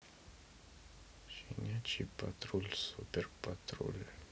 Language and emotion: Russian, neutral